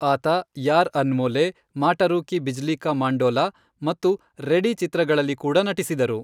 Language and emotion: Kannada, neutral